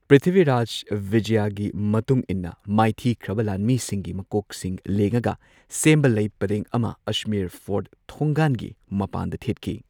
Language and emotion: Manipuri, neutral